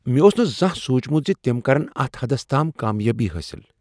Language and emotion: Kashmiri, surprised